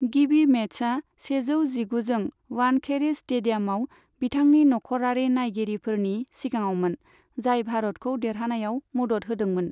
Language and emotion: Bodo, neutral